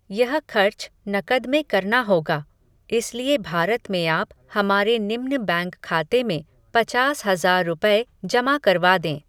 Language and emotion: Hindi, neutral